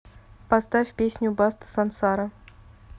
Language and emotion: Russian, neutral